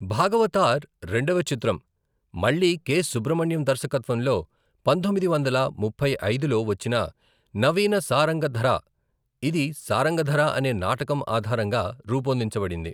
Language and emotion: Telugu, neutral